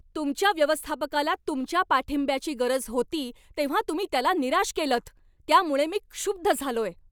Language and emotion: Marathi, angry